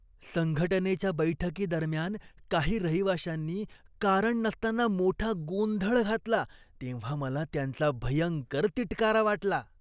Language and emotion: Marathi, disgusted